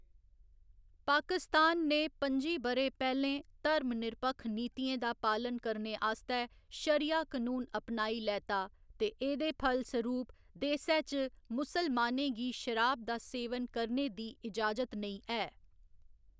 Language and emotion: Dogri, neutral